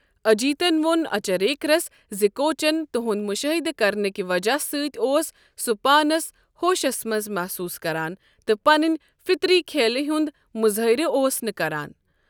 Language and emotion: Kashmiri, neutral